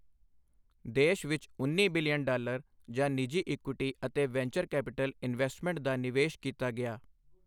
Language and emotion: Punjabi, neutral